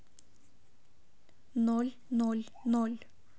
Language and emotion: Russian, neutral